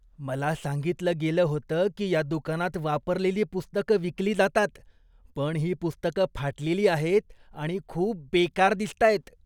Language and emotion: Marathi, disgusted